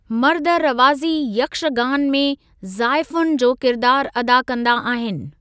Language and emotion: Sindhi, neutral